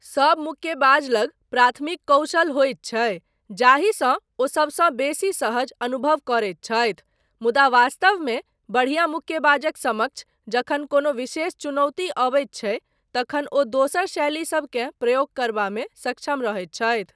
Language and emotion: Maithili, neutral